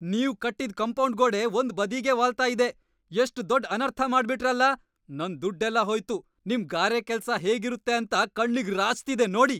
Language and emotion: Kannada, angry